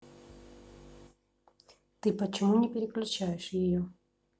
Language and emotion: Russian, neutral